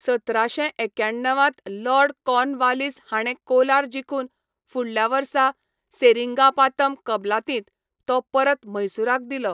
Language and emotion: Goan Konkani, neutral